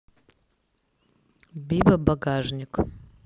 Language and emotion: Russian, neutral